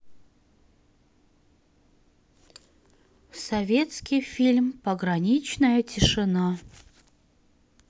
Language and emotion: Russian, neutral